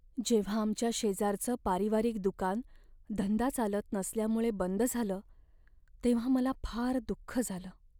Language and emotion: Marathi, sad